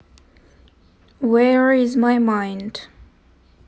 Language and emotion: Russian, neutral